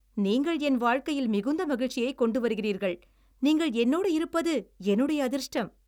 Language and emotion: Tamil, happy